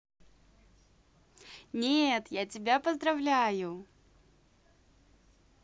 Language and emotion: Russian, positive